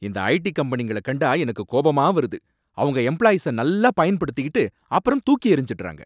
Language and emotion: Tamil, angry